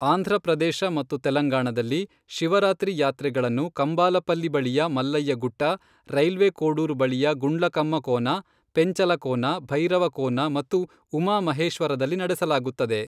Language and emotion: Kannada, neutral